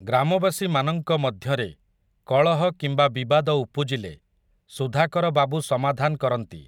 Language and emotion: Odia, neutral